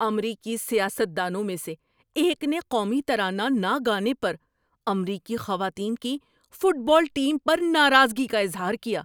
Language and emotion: Urdu, angry